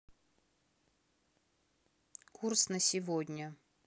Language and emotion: Russian, neutral